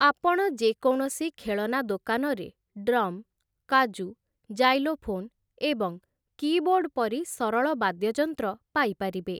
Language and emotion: Odia, neutral